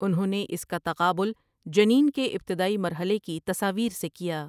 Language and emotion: Urdu, neutral